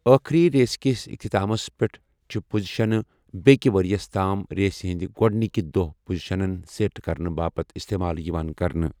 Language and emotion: Kashmiri, neutral